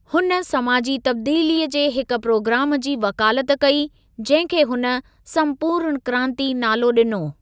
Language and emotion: Sindhi, neutral